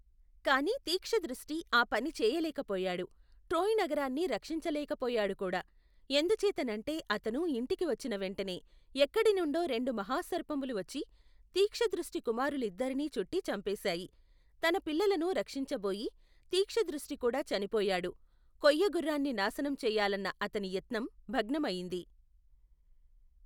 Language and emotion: Telugu, neutral